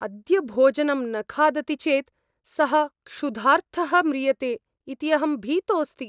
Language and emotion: Sanskrit, fearful